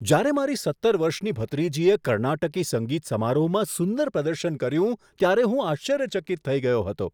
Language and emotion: Gujarati, surprised